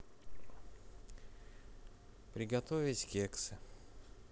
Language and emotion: Russian, neutral